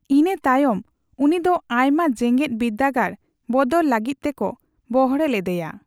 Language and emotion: Santali, neutral